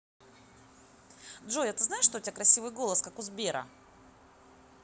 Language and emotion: Russian, positive